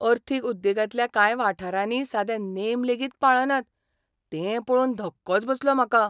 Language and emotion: Goan Konkani, surprised